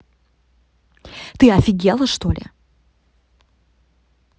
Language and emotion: Russian, angry